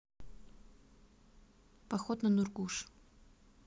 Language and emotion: Russian, neutral